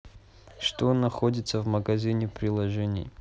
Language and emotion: Russian, neutral